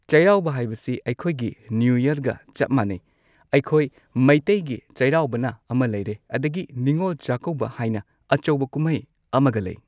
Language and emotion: Manipuri, neutral